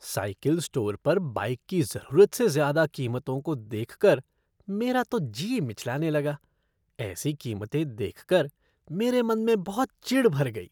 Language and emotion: Hindi, disgusted